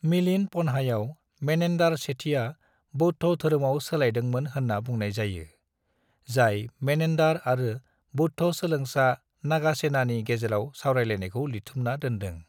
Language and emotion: Bodo, neutral